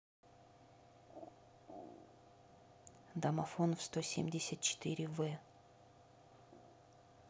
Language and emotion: Russian, neutral